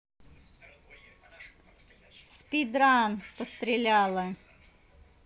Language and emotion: Russian, neutral